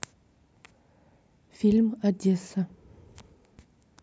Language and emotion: Russian, neutral